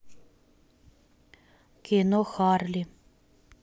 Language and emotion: Russian, neutral